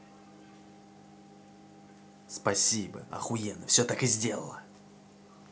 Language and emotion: Russian, angry